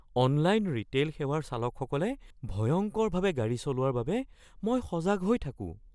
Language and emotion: Assamese, fearful